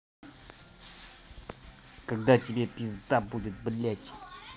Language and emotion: Russian, angry